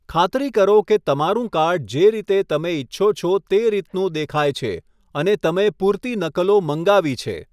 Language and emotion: Gujarati, neutral